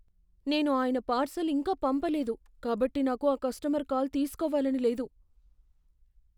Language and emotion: Telugu, fearful